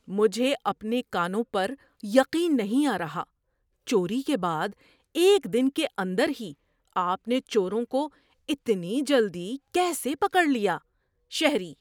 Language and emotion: Urdu, surprised